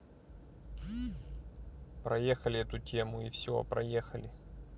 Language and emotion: Russian, neutral